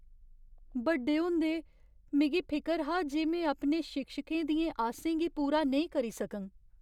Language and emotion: Dogri, fearful